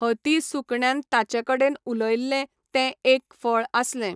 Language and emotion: Goan Konkani, neutral